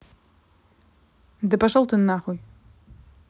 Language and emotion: Russian, angry